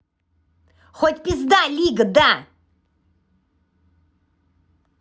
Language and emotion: Russian, angry